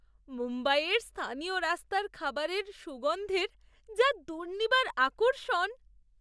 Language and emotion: Bengali, surprised